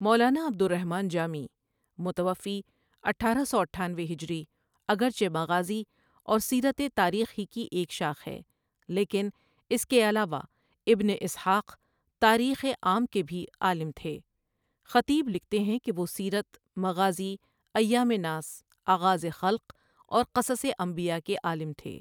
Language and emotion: Urdu, neutral